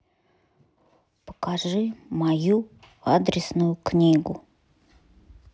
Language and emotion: Russian, neutral